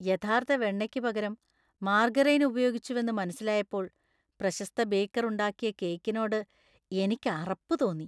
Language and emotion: Malayalam, disgusted